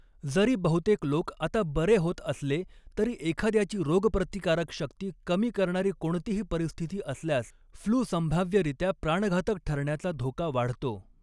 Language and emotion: Marathi, neutral